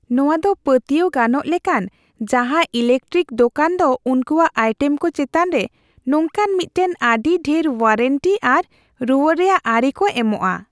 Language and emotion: Santali, happy